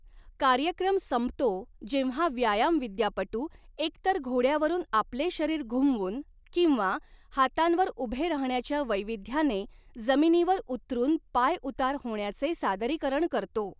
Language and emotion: Marathi, neutral